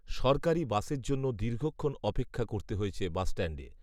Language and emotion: Bengali, neutral